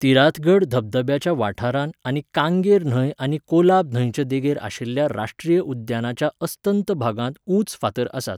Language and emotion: Goan Konkani, neutral